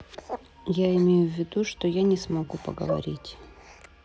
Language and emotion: Russian, neutral